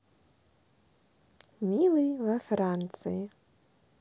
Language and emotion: Russian, positive